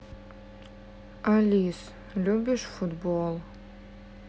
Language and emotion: Russian, sad